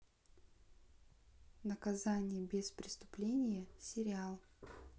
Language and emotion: Russian, neutral